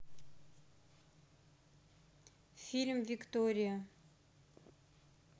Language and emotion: Russian, neutral